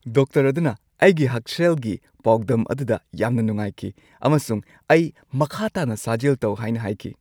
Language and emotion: Manipuri, happy